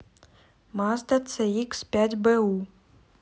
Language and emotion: Russian, neutral